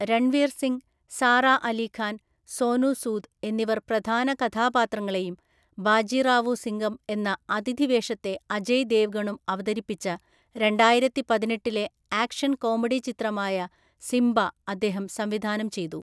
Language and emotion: Malayalam, neutral